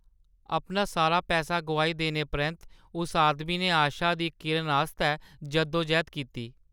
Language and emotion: Dogri, sad